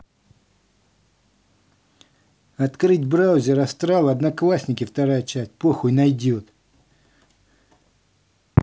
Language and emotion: Russian, angry